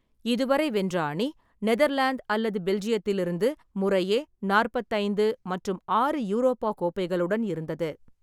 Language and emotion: Tamil, neutral